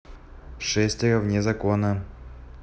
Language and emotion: Russian, neutral